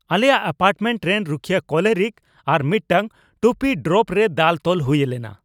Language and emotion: Santali, angry